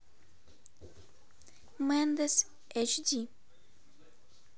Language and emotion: Russian, neutral